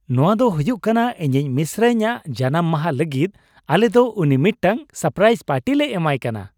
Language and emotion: Santali, happy